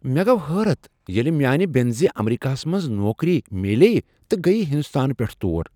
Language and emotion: Kashmiri, surprised